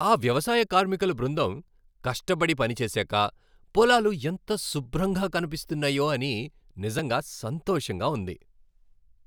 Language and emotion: Telugu, happy